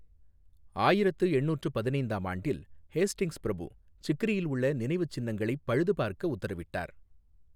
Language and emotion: Tamil, neutral